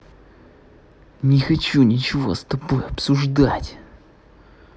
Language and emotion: Russian, angry